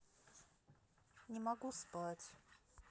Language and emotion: Russian, sad